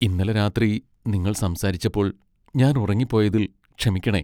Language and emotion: Malayalam, sad